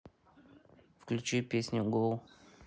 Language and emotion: Russian, neutral